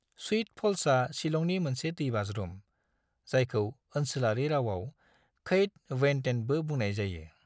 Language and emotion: Bodo, neutral